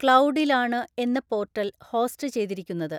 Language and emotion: Malayalam, neutral